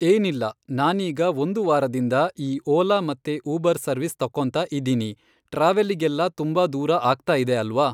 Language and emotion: Kannada, neutral